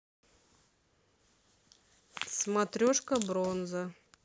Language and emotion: Russian, neutral